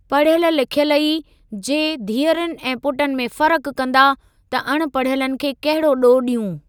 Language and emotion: Sindhi, neutral